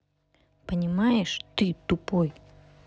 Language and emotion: Russian, angry